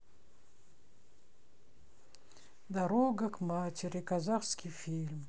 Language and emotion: Russian, sad